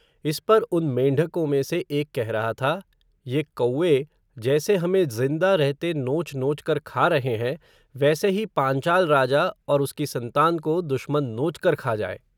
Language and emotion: Hindi, neutral